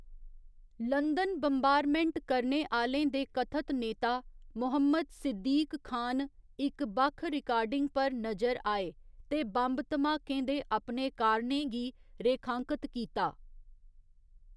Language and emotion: Dogri, neutral